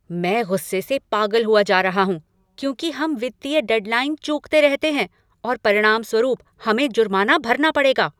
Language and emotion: Hindi, angry